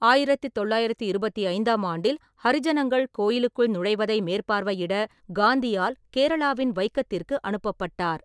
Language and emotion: Tamil, neutral